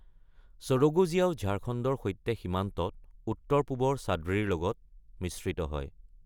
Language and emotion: Assamese, neutral